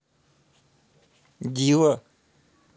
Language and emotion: Russian, neutral